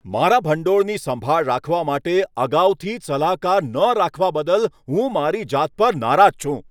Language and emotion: Gujarati, angry